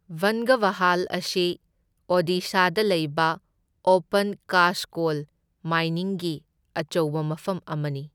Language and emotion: Manipuri, neutral